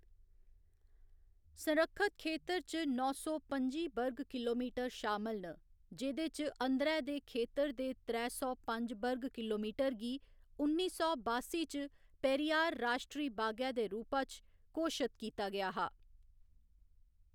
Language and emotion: Dogri, neutral